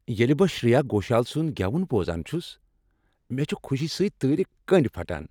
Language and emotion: Kashmiri, happy